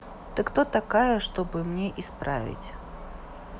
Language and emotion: Russian, neutral